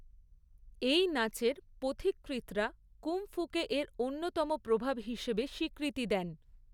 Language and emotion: Bengali, neutral